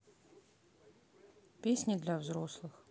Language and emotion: Russian, neutral